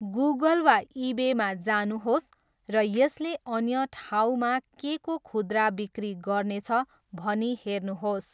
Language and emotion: Nepali, neutral